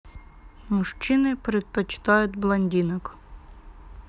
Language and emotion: Russian, neutral